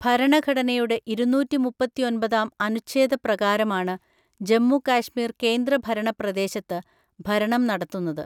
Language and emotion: Malayalam, neutral